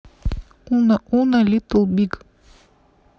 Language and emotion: Russian, neutral